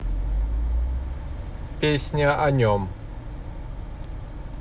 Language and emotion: Russian, neutral